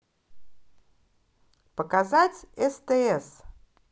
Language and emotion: Russian, positive